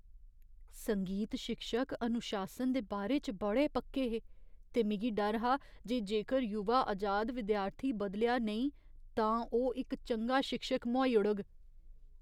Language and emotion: Dogri, fearful